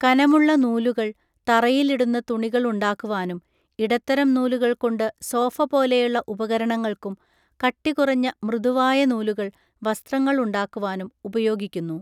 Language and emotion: Malayalam, neutral